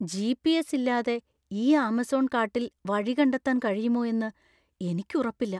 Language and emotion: Malayalam, fearful